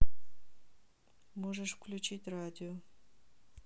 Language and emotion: Russian, neutral